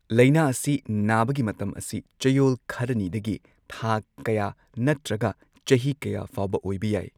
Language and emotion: Manipuri, neutral